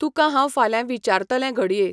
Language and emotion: Goan Konkani, neutral